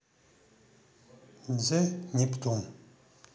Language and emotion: Russian, neutral